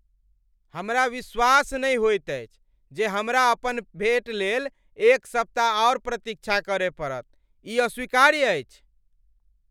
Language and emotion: Maithili, angry